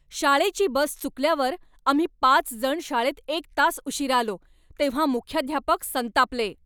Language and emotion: Marathi, angry